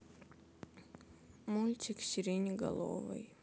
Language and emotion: Russian, sad